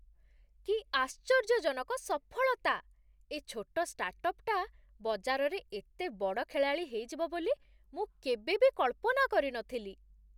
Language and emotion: Odia, surprised